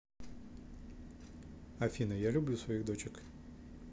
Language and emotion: Russian, neutral